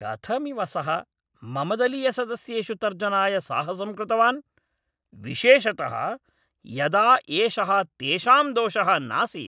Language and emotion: Sanskrit, angry